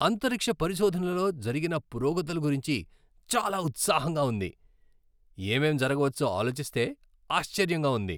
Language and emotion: Telugu, happy